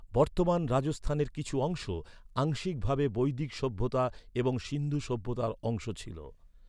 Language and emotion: Bengali, neutral